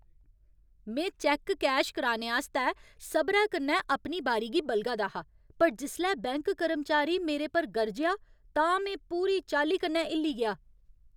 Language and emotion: Dogri, angry